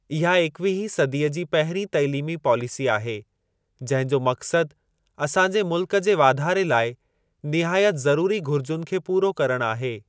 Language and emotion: Sindhi, neutral